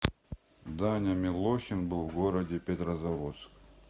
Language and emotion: Russian, neutral